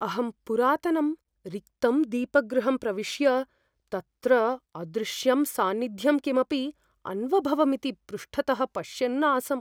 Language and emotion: Sanskrit, fearful